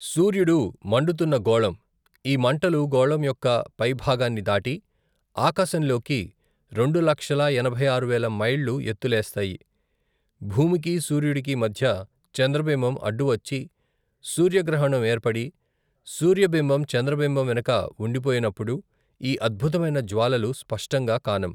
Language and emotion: Telugu, neutral